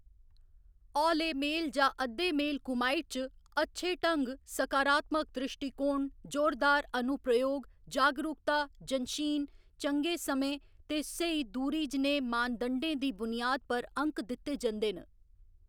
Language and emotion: Dogri, neutral